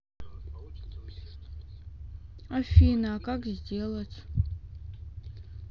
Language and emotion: Russian, sad